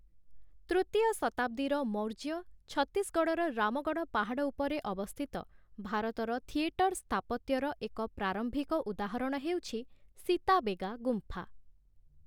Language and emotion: Odia, neutral